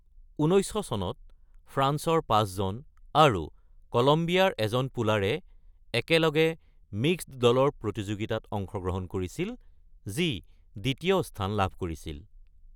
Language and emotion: Assamese, neutral